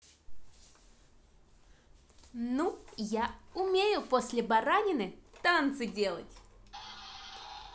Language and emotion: Russian, positive